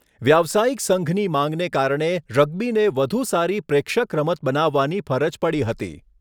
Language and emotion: Gujarati, neutral